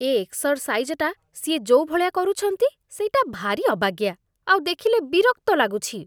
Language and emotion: Odia, disgusted